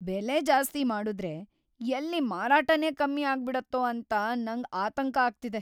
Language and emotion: Kannada, fearful